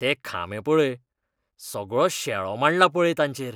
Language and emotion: Goan Konkani, disgusted